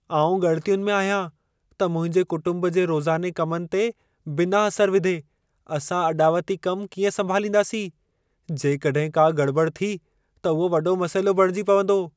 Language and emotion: Sindhi, fearful